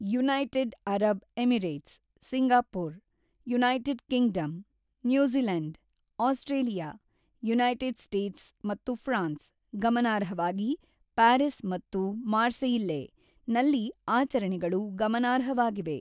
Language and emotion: Kannada, neutral